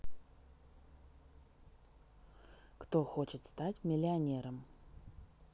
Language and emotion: Russian, neutral